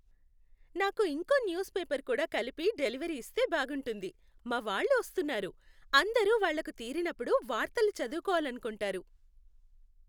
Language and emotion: Telugu, happy